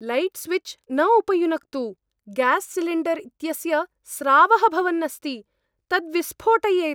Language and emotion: Sanskrit, fearful